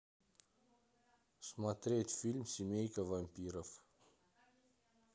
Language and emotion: Russian, neutral